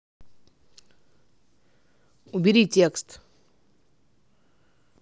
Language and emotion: Russian, angry